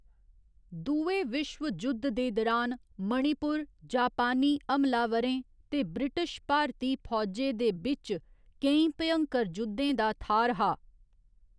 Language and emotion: Dogri, neutral